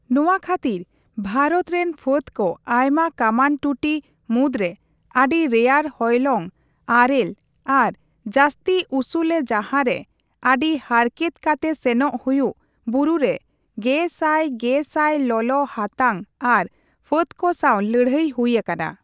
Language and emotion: Santali, neutral